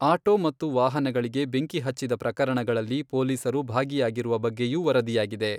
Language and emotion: Kannada, neutral